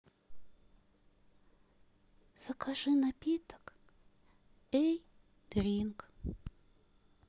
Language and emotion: Russian, sad